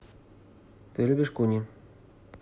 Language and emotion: Russian, neutral